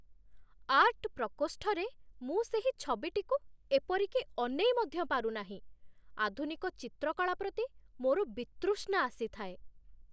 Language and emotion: Odia, disgusted